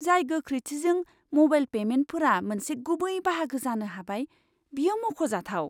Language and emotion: Bodo, surprised